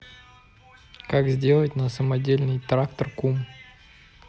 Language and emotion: Russian, neutral